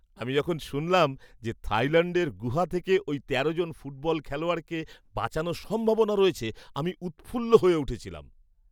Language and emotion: Bengali, happy